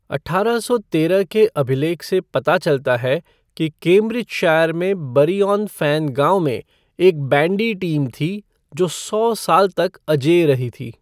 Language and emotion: Hindi, neutral